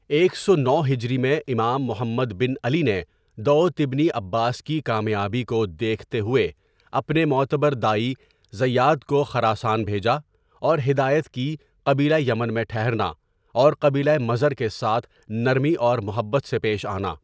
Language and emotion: Urdu, neutral